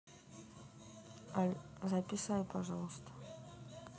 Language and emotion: Russian, neutral